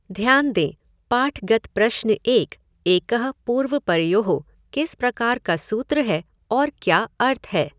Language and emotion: Hindi, neutral